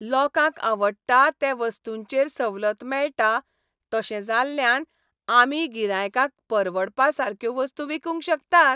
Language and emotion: Goan Konkani, happy